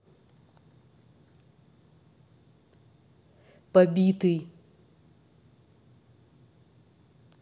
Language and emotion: Russian, neutral